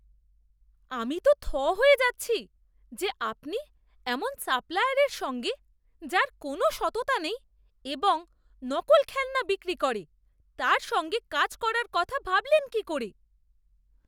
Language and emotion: Bengali, disgusted